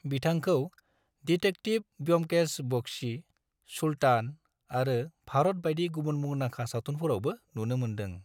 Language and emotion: Bodo, neutral